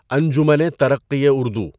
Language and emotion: Urdu, neutral